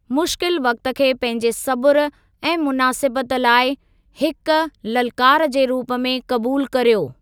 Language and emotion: Sindhi, neutral